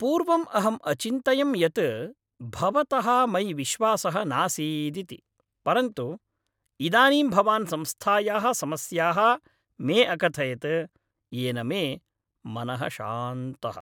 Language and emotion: Sanskrit, happy